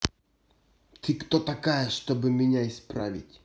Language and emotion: Russian, angry